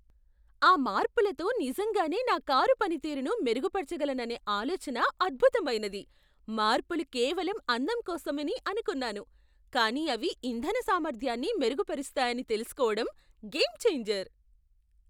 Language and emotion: Telugu, surprised